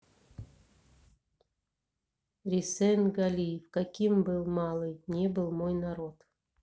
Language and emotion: Russian, neutral